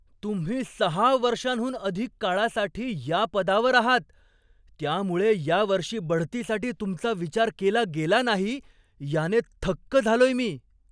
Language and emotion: Marathi, surprised